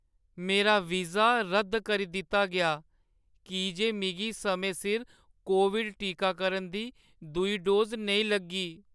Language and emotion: Dogri, sad